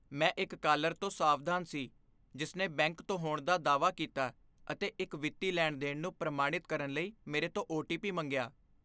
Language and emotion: Punjabi, fearful